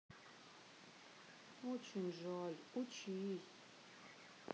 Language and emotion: Russian, sad